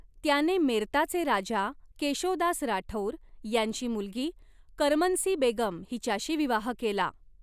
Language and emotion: Marathi, neutral